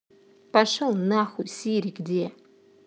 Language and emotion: Russian, angry